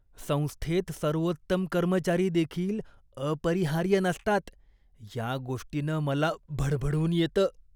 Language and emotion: Marathi, disgusted